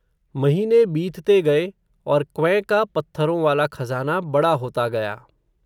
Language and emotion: Hindi, neutral